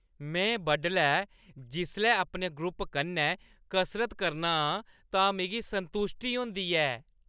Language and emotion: Dogri, happy